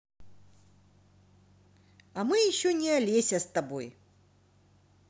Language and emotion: Russian, positive